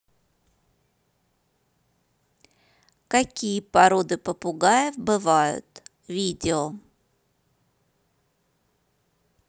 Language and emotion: Russian, neutral